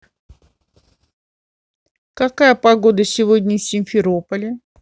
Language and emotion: Russian, neutral